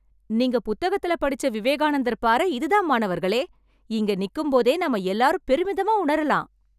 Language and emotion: Tamil, happy